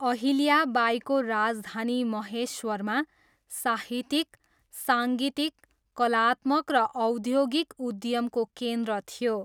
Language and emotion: Nepali, neutral